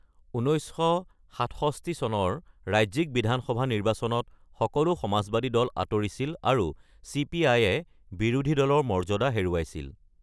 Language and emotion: Assamese, neutral